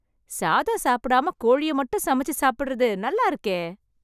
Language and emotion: Tamil, happy